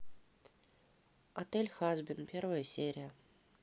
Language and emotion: Russian, neutral